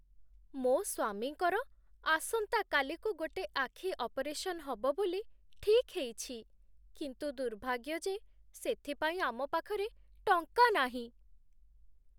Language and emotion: Odia, sad